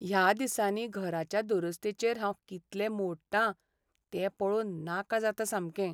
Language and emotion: Goan Konkani, sad